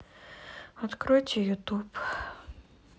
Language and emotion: Russian, sad